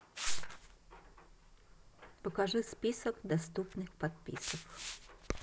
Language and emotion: Russian, neutral